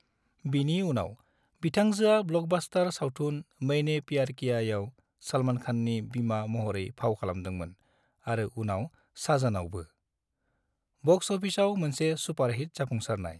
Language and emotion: Bodo, neutral